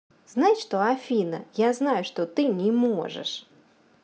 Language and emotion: Russian, neutral